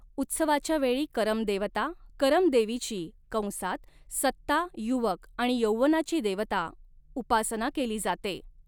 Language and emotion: Marathi, neutral